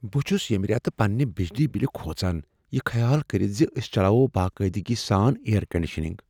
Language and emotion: Kashmiri, fearful